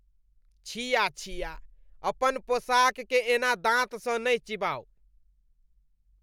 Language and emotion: Maithili, disgusted